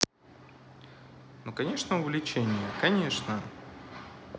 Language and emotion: Russian, positive